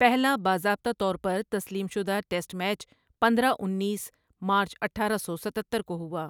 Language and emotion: Urdu, neutral